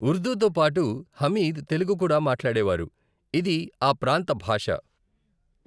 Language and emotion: Telugu, neutral